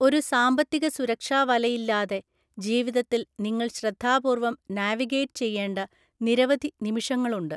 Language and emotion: Malayalam, neutral